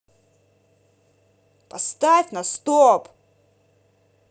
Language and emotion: Russian, angry